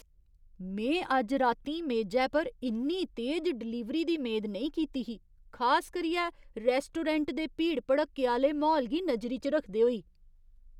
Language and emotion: Dogri, surprised